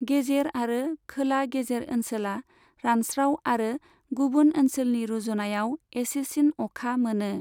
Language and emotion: Bodo, neutral